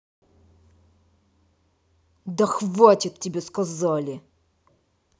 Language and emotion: Russian, angry